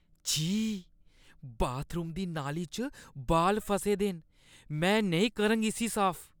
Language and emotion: Dogri, disgusted